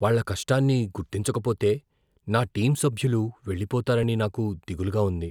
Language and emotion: Telugu, fearful